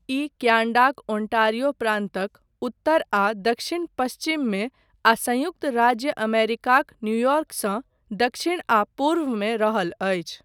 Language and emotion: Maithili, neutral